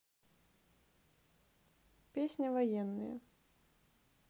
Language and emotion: Russian, neutral